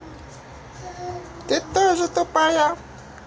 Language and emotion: Russian, positive